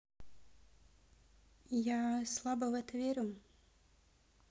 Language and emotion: Russian, neutral